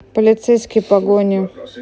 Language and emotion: Russian, neutral